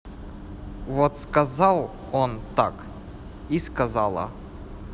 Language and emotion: Russian, neutral